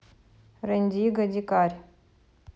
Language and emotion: Russian, neutral